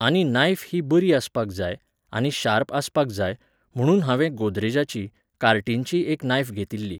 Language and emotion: Goan Konkani, neutral